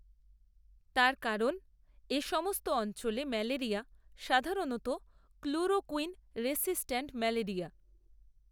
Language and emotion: Bengali, neutral